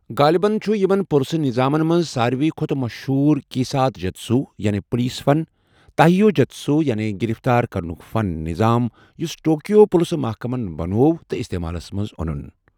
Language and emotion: Kashmiri, neutral